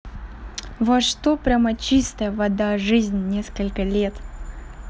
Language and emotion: Russian, neutral